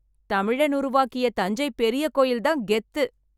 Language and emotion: Tamil, happy